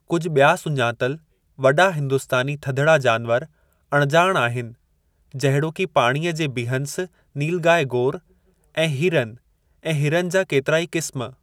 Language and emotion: Sindhi, neutral